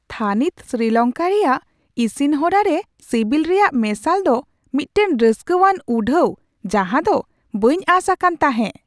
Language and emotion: Santali, surprised